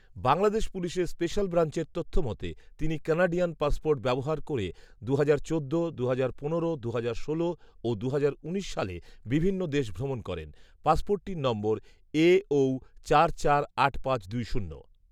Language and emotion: Bengali, neutral